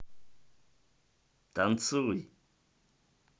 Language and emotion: Russian, positive